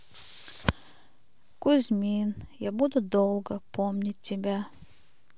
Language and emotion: Russian, sad